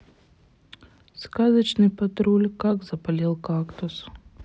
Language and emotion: Russian, sad